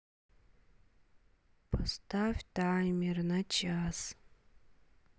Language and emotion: Russian, neutral